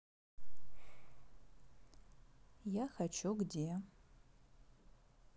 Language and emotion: Russian, sad